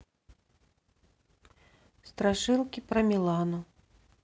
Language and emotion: Russian, neutral